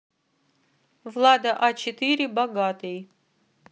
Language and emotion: Russian, neutral